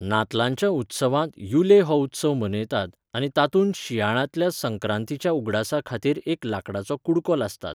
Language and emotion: Goan Konkani, neutral